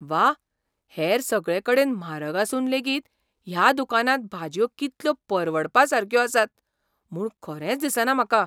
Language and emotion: Goan Konkani, surprised